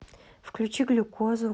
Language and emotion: Russian, neutral